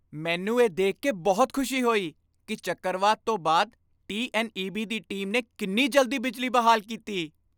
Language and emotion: Punjabi, happy